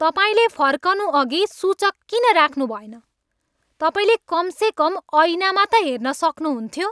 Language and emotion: Nepali, angry